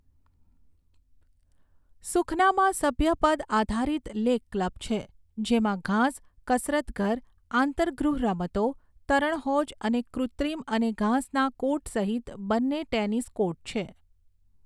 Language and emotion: Gujarati, neutral